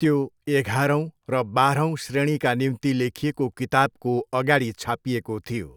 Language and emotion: Nepali, neutral